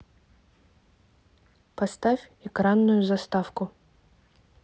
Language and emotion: Russian, neutral